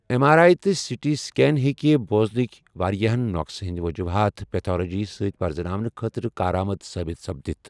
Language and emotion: Kashmiri, neutral